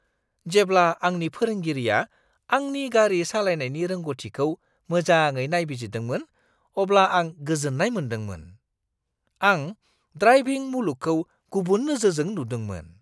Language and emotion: Bodo, surprised